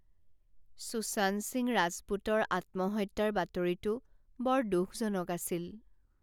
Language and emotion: Assamese, sad